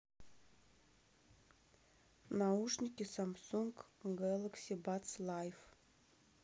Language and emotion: Russian, neutral